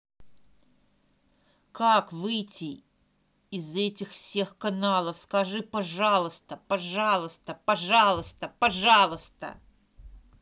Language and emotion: Russian, angry